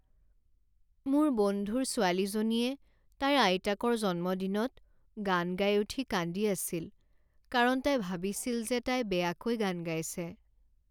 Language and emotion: Assamese, sad